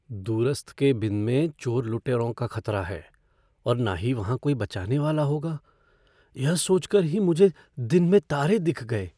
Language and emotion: Hindi, fearful